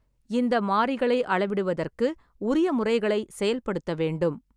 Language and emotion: Tamil, neutral